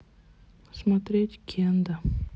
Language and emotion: Russian, neutral